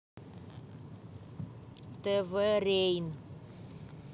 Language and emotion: Russian, angry